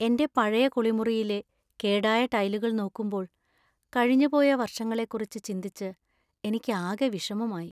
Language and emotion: Malayalam, sad